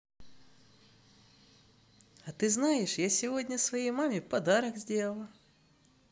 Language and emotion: Russian, positive